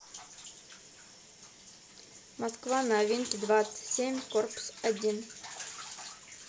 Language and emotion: Russian, neutral